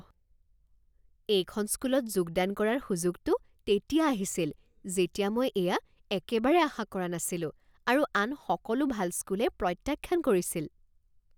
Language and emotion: Assamese, surprised